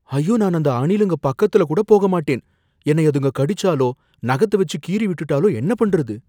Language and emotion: Tamil, fearful